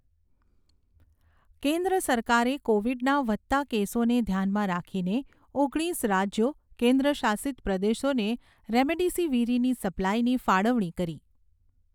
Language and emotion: Gujarati, neutral